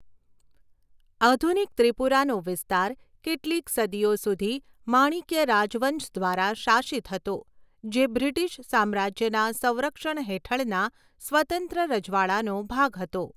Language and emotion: Gujarati, neutral